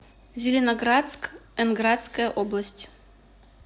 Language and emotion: Russian, neutral